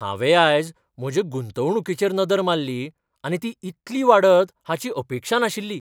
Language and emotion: Goan Konkani, surprised